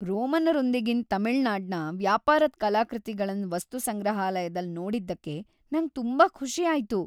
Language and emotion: Kannada, happy